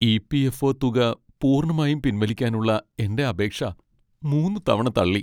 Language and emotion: Malayalam, sad